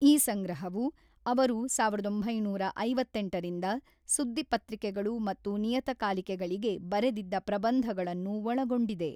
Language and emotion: Kannada, neutral